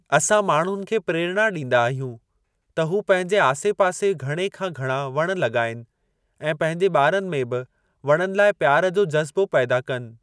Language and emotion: Sindhi, neutral